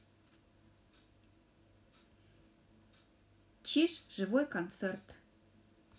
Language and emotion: Russian, neutral